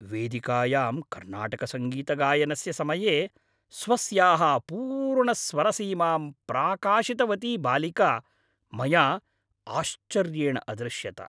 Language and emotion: Sanskrit, happy